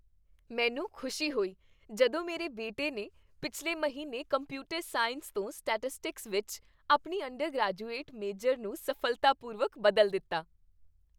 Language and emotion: Punjabi, happy